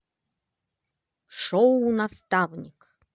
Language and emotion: Russian, positive